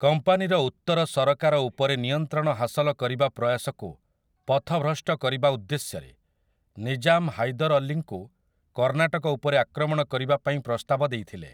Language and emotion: Odia, neutral